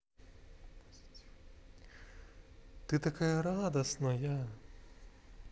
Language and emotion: Russian, positive